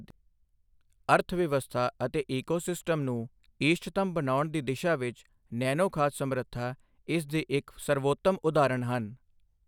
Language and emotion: Punjabi, neutral